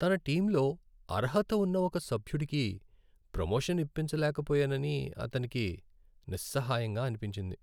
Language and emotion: Telugu, sad